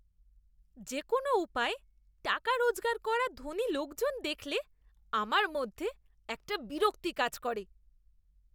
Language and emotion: Bengali, disgusted